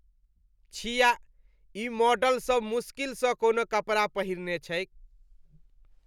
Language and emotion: Maithili, disgusted